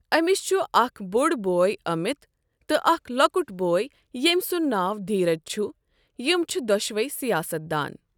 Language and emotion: Kashmiri, neutral